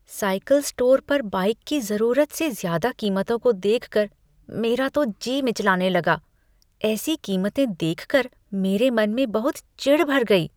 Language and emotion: Hindi, disgusted